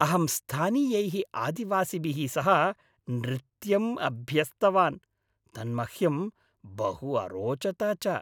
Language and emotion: Sanskrit, happy